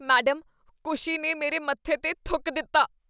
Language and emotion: Punjabi, disgusted